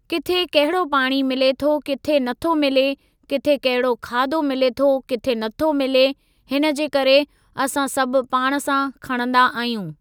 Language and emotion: Sindhi, neutral